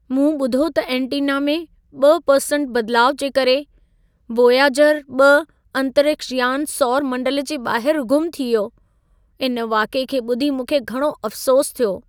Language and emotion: Sindhi, sad